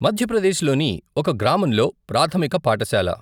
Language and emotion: Telugu, neutral